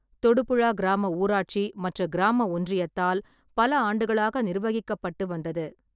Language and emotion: Tamil, neutral